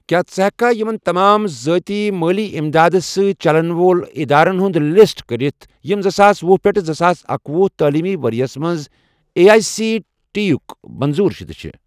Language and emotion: Kashmiri, neutral